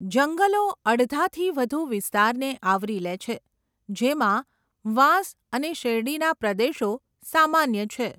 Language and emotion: Gujarati, neutral